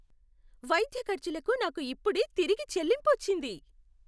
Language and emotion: Telugu, happy